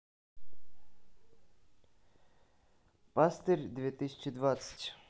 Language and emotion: Russian, neutral